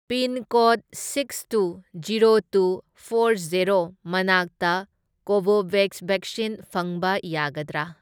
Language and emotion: Manipuri, neutral